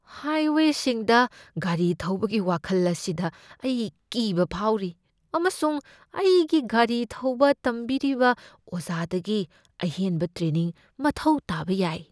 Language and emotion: Manipuri, fearful